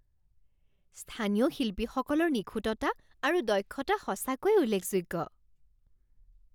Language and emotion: Assamese, surprised